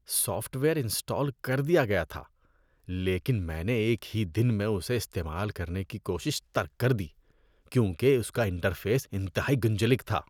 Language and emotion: Urdu, disgusted